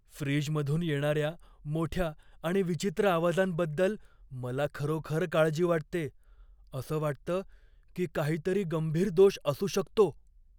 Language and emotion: Marathi, fearful